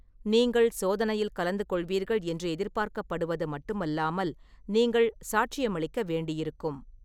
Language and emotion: Tamil, neutral